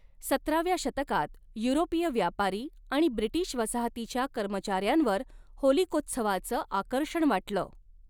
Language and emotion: Marathi, neutral